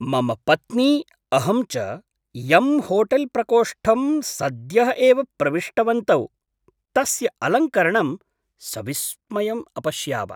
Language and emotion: Sanskrit, surprised